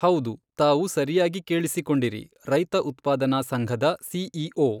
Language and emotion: Kannada, neutral